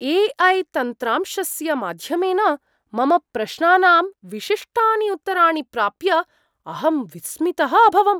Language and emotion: Sanskrit, surprised